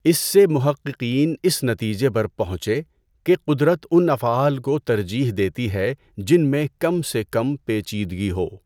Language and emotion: Urdu, neutral